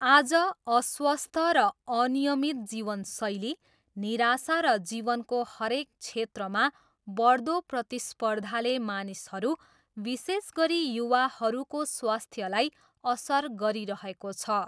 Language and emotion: Nepali, neutral